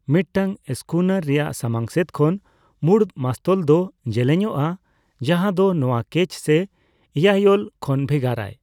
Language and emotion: Santali, neutral